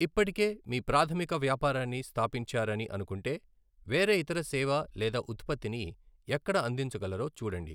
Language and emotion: Telugu, neutral